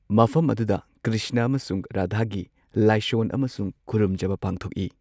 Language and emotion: Manipuri, neutral